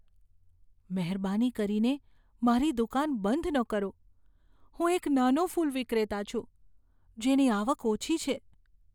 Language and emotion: Gujarati, fearful